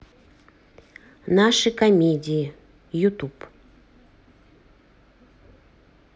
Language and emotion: Russian, neutral